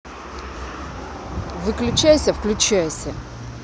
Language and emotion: Russian, angry